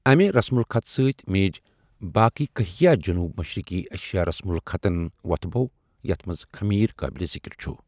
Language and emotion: Kashmiri, neutral